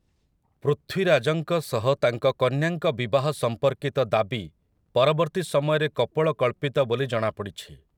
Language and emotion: Odia, neutral